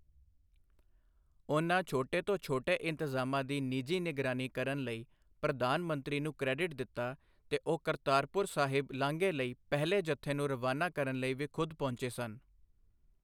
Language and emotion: Punjabi, neutral